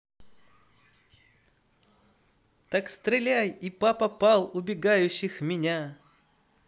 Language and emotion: Russian, positive